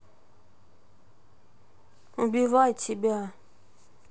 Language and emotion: Russian, sad